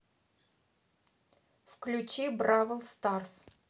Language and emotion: Russian, neutral